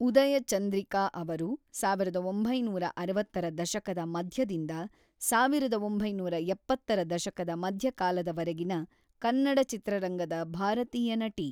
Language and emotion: Kannada, neutral